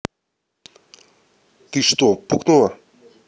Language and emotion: Russian, neutral